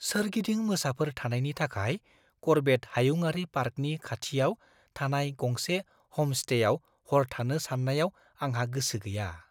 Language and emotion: Bodo, fearful